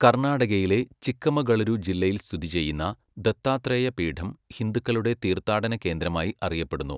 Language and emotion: Malayalam, neutral